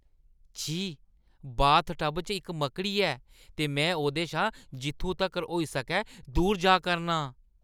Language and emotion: Dogri, disgusted